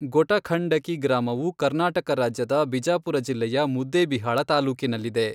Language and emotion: Kannada, neutral